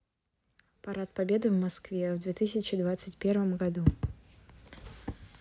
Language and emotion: Russian, neutral